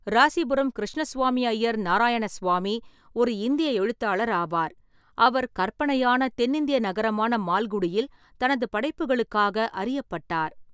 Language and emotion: Tamil, neutral